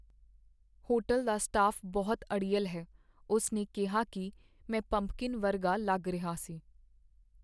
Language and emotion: Punjabi, sad